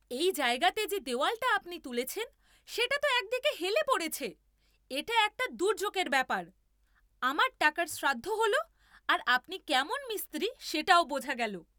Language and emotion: Bengali, angry